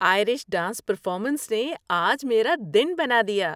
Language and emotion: Urdu, happy